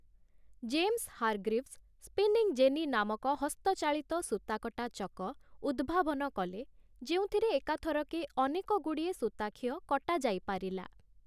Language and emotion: Odia, neutral